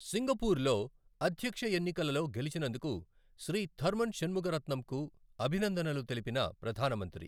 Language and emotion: Telugu, neutral